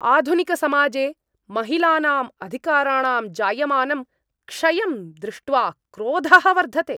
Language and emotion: Sanskrit, angry